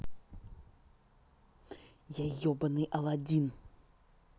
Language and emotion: Russian, angry